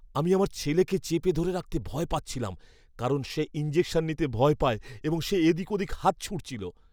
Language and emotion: Bengali, fearful